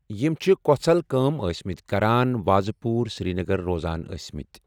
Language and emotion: Kashmiri, neutral